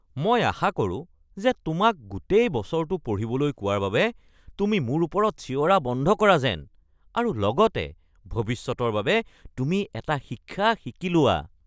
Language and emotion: Assamese, disgusted